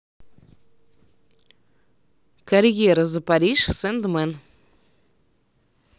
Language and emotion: Russian, neutral